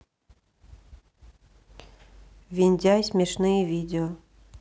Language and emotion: Russian, neutral